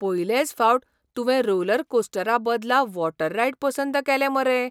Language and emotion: Goan Konkani, surprised